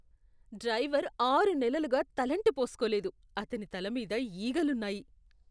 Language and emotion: Telugu, disgusted